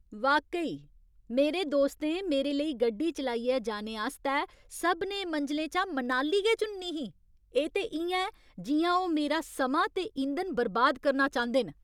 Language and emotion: Dogri, angry